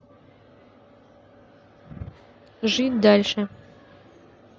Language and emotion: Russian, neutral